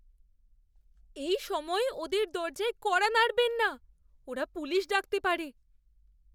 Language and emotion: Bengali, fearful